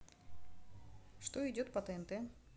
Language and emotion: Russian, neutral